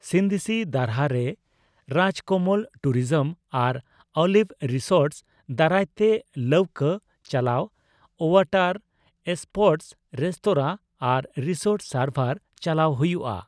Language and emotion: Santali, neutral